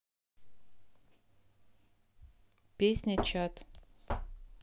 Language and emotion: Russian, neutral